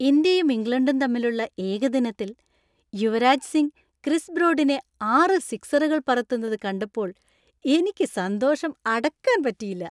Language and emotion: Malayalam, happy